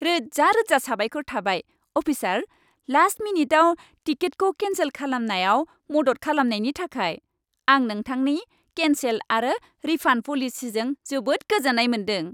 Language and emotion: Bodo, happy